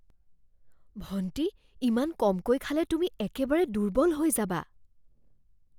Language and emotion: Assamese, fearful